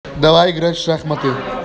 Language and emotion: Russian, positive